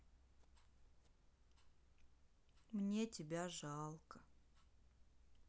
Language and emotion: Russian, sad